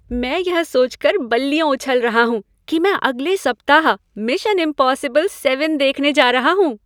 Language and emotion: Hindi, happy